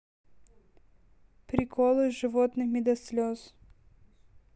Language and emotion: Russian, neutral